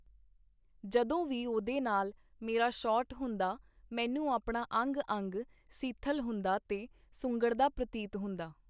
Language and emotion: Punjabi, neutral